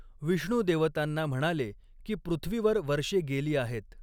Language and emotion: Marathi, neutral